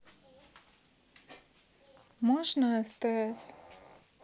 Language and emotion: Russian, neutral